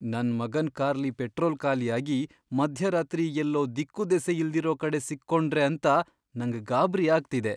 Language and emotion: Kannada, fearful